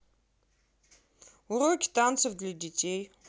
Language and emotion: Russian, neutral